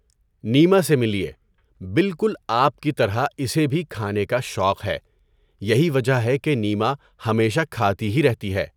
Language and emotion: Urdu, neutral